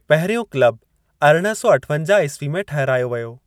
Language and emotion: Sindhi, neutral